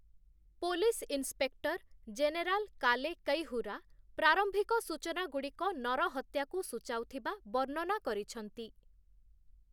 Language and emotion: Odia, neutral